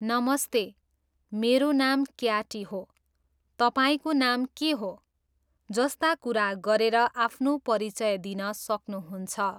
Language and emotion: Nepali, neutral